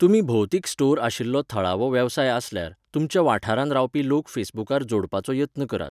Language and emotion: Goan Konkani, neutral